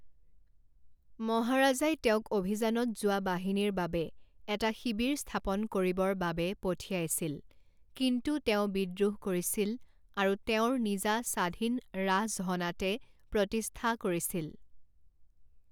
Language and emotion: Assamese, neutral